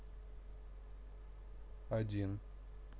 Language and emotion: Russian, neutral